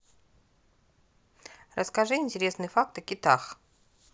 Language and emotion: Russian, neutral